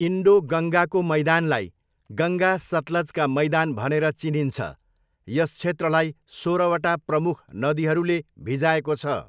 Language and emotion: Nepali, neutral